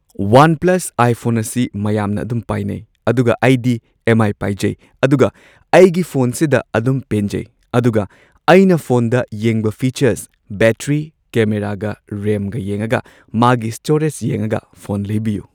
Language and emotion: Manipuri, neutral